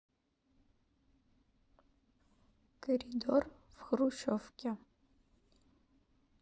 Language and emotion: Russian, neutral